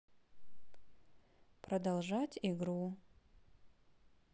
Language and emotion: Russian, neutral